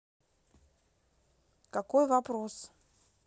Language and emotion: Russian, neutral